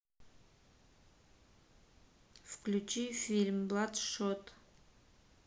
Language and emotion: Russian, neutral